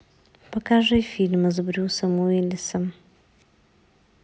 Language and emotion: Russian, neutral